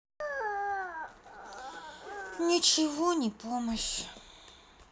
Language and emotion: Russian, sad